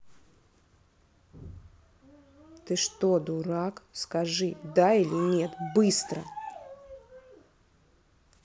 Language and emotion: Russian, angry